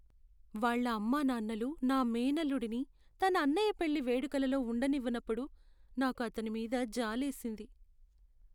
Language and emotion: Telugu, sad